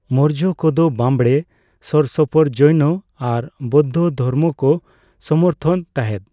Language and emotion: Santali, neutral